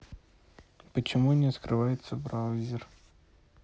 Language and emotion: Russian, neutral